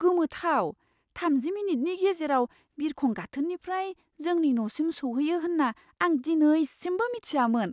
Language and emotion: Bodo, surprised